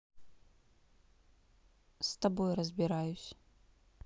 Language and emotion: Russian, neutral